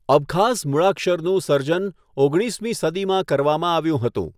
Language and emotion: Gujarati, neutral